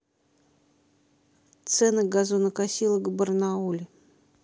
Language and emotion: Russian, neutral